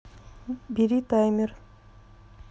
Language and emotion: Russian, neutral